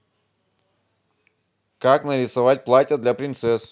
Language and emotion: Russian, positive